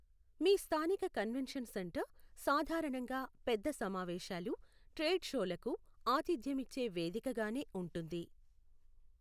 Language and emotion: Telugu, neutral